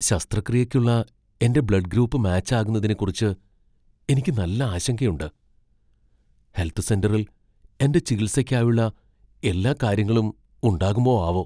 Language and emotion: Malayalam, fearful